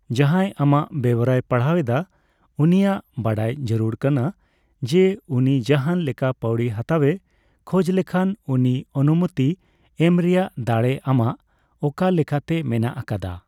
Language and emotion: Santali, neutral